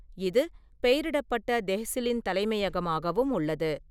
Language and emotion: Tamil, neutral